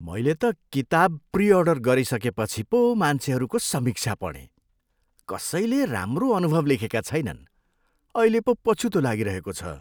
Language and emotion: Nepali, disgusted